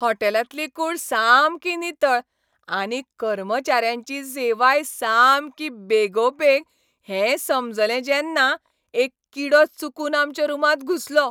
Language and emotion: Goan Konkani, happy